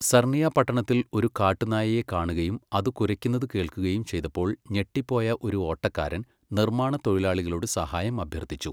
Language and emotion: Malayalam, neutral